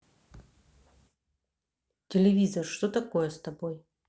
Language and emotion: Russian, neutral